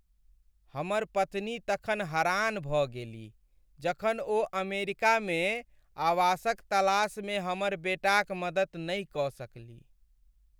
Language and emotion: Maithili, sad